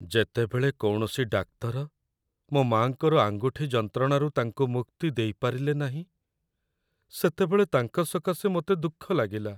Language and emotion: Odia, sad